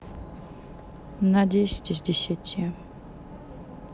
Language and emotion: Russian, neutral